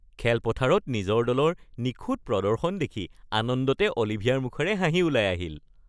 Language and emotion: Assamese, happy